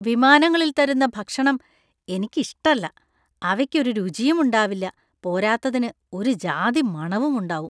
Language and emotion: Malayalam, disgusted